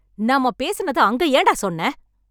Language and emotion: Tamil, angry